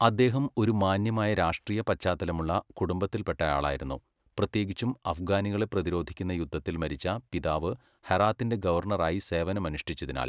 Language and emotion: Malayalam, neutral